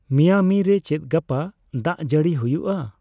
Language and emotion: Santali, neutral